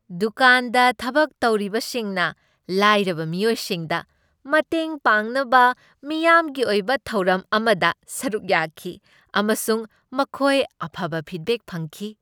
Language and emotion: Manipuri, happy